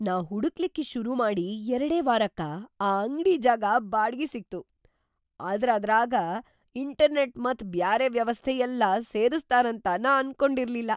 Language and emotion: Kannada, surprised